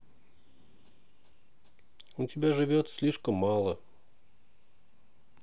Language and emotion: Russian, sad